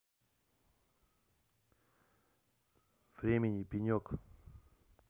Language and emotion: Russian, neutral